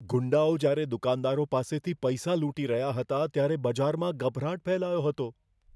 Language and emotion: Gujarati, fearful